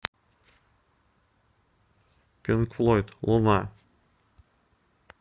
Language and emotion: Russian, neutral